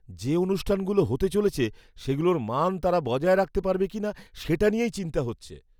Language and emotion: Bengali, fearful